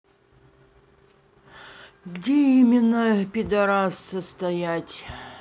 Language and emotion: Russian, neutral